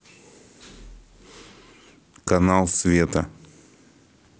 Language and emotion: Russian, neutral